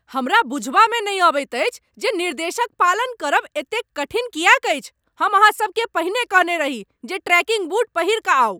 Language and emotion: Maithili, angry